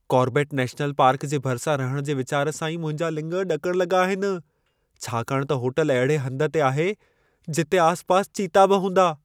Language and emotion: Sindhi, fearful